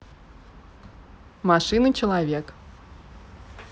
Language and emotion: Russian, neutral